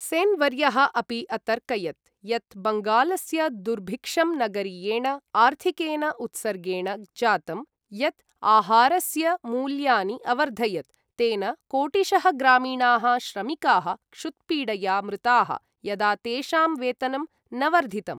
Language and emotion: Sanskrit, neutral